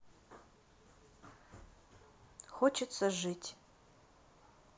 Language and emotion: Russian, neutral